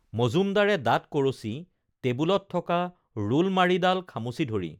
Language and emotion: Assamese, neutral